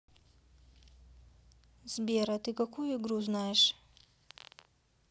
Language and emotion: Russian, neutral